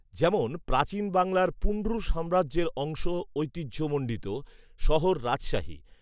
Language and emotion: Bengali, neutral